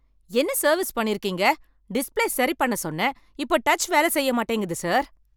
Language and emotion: Tamil, angry